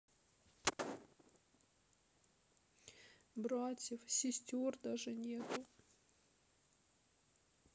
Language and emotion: Russian, sad